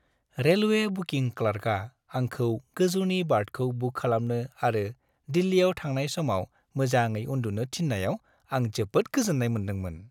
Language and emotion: Bodo, happy